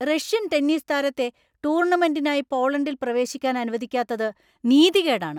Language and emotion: Malayalam, angry